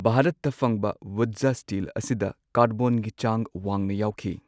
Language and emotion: Manipuri, neutral